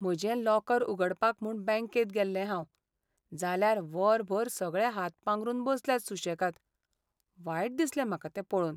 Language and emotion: Goan Konkani, sad